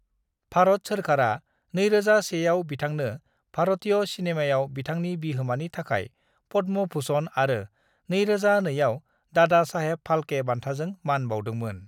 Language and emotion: Bodo, neutral